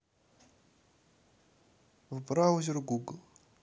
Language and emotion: Russian, neutral